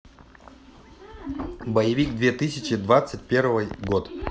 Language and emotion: Russian, neutral